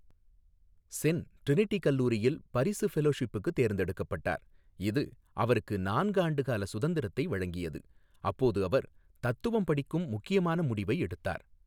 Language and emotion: Tamil, neutral